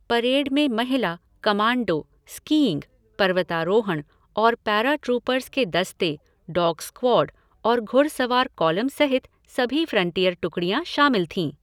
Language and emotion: Hindi, neutral